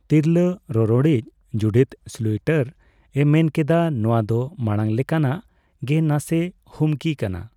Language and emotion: Santali, neutral